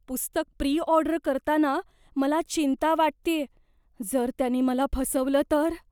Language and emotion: Marathi, fearful